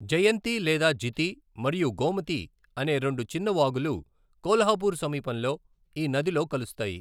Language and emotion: Telugu, neutral